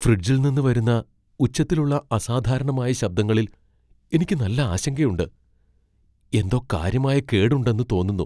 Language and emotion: Malayalam, fearful